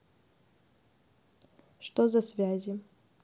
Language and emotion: Russian, neutral